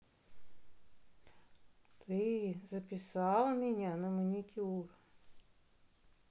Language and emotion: Russian, neutral